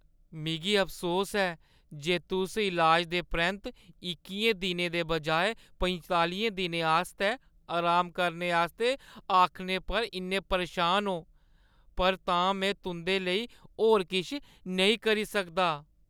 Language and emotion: Dogri, sad